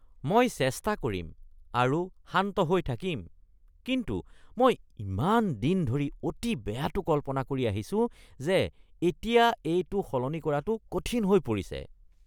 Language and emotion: Assamese, disgusted